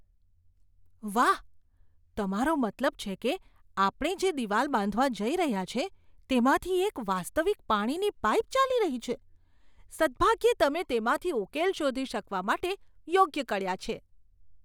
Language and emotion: Gujarati, surprised